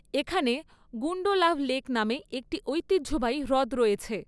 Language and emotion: Bengali, neutral